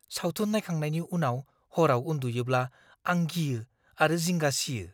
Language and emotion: Bodo, fearful